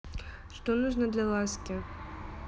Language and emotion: Russian, neutral